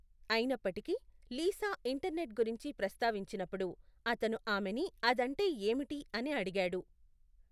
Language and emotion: Telugu, neutral